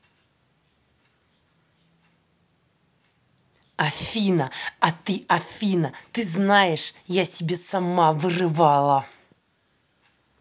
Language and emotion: Russian, angry